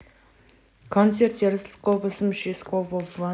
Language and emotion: Russian, neutral